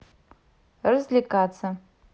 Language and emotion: Russian, neutral